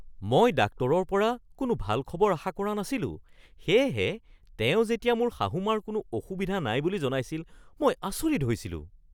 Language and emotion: Assamese, surprised